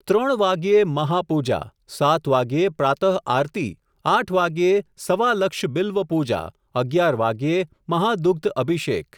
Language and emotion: Gujarati, neutral